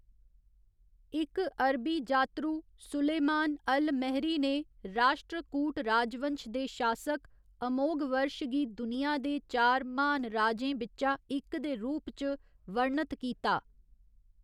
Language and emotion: Dogri, neutral